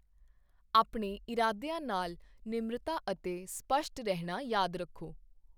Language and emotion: Punjabi, neutral